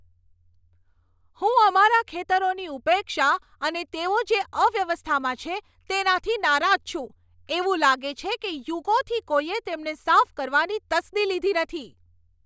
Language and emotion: Gujarati, angry